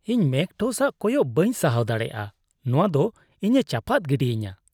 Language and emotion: Santali, disgusted